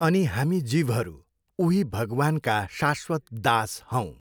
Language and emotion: Nepali, neutral